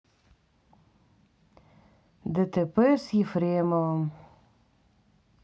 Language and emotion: Russian, sad